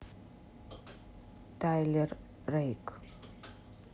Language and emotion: Russian, neutral